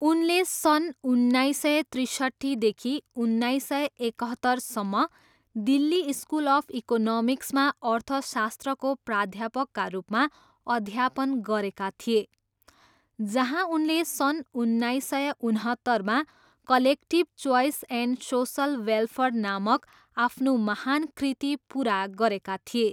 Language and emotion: Nepali, neutral